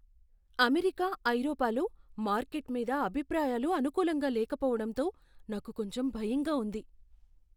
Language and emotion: Telugu, fearful